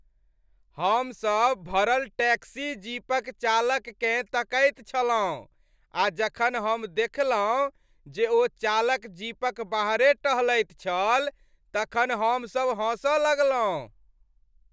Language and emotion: Maithili, happy